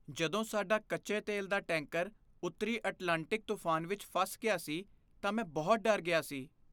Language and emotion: Punjabi, fearful